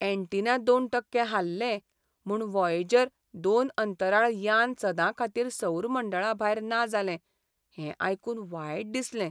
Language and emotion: Goan Konkani, sad